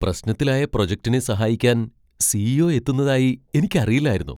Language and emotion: Malayalam, surprised